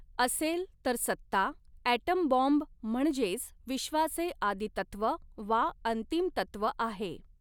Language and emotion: Marathi, neutral